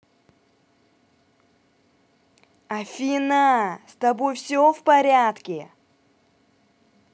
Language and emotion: Russian, angry